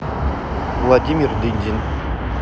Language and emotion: Russian, neutral